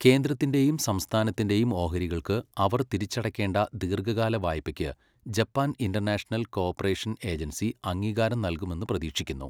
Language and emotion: Malayalam, neutral